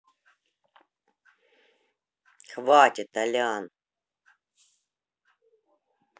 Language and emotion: Russian, neutral